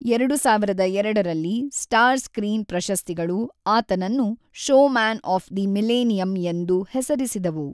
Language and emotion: Kannada, neutral